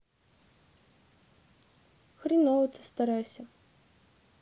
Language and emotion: Russian, sad